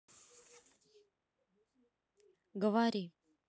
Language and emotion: Russian, neutral